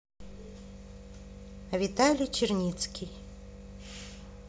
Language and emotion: Russian, neutral